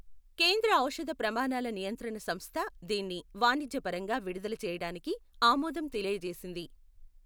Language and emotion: Telugu, neutral